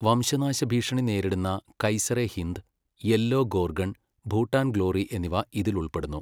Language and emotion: Malayalam, neutral